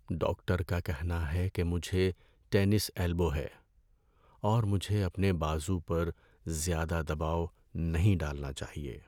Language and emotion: Urdu, sad